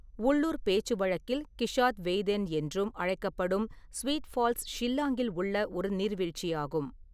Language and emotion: Tamil, neutral